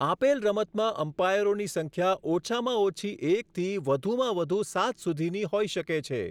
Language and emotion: Gujarati, neutral